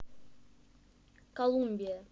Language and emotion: Russian, neutral